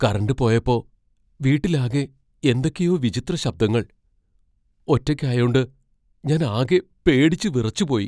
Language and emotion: Malayalam, fearful